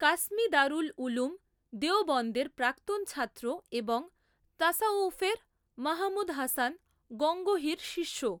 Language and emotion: Bengali, neutral